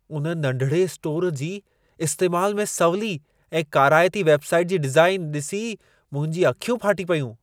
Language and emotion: Sindhi, surprised